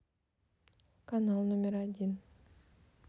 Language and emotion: Russian, neutral